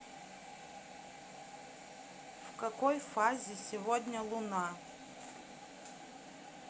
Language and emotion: Russian, neutral